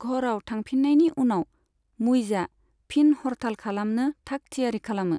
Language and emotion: Bodo, neutral